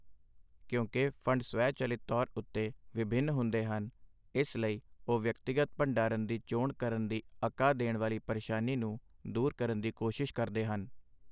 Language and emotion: Punjabi, neutral